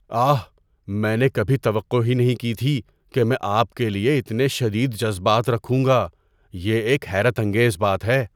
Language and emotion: Urdu, surprised